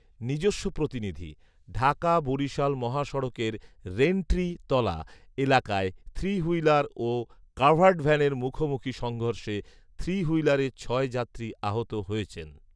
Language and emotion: Bengali, neutral